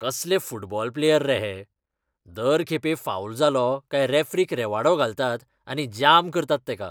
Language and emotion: Goan Konkani, disgusted